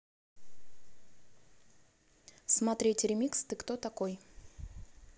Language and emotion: Russian, neutral